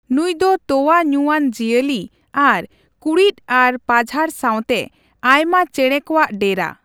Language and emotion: Santali, neutral